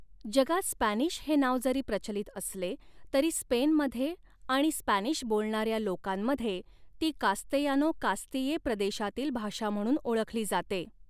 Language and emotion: Marathi, neutral